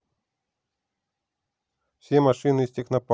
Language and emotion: Russian, neutral